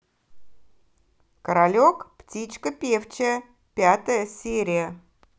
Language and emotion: Russian, positive